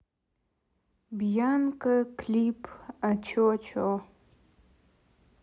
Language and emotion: Russian, neutral